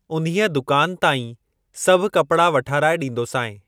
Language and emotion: Sindhi, neutral